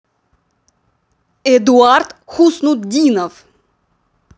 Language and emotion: Russian, angry